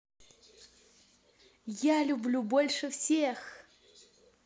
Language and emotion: Russian, positive